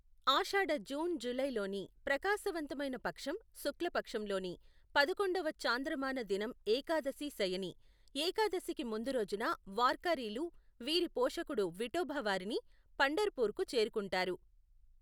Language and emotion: Telugu, neutral